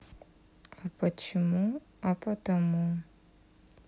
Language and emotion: Russian, sad